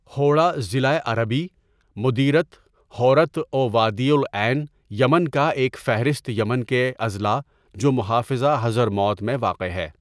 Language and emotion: Urdu, neutral